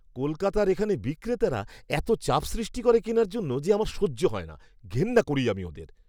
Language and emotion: Bengali, disgusted